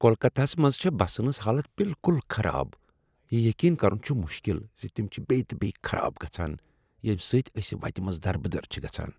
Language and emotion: Kashmiri, disgusted